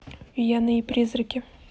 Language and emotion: Russian, neutral